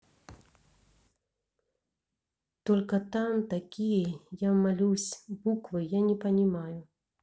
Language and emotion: Russian, neutral